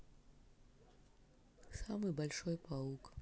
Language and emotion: Russian, neutral